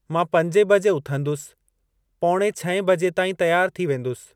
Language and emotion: Sindhi, neutral